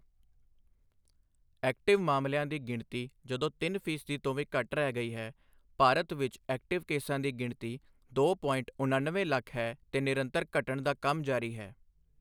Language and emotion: Punjabi, neutral